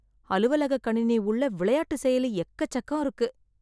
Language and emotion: Tamil, disgusted